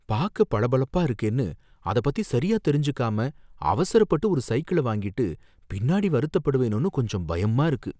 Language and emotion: Tamil, fearful